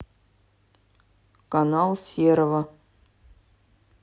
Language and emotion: Russian, neutral